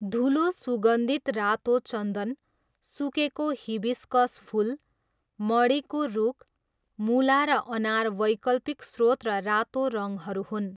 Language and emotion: Nepali, neutral